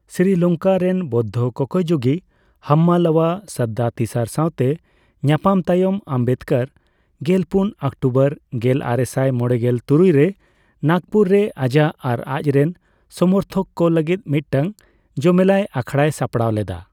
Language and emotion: Santali, neutral